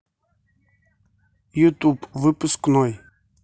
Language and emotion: Russian, neutral